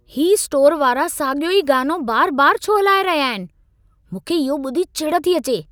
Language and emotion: Sindhi, angry